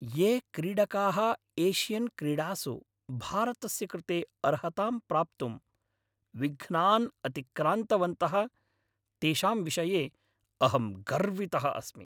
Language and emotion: Sanskrit, happy